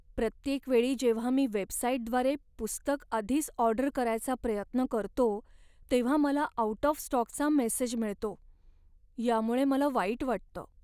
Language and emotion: Marathi, sad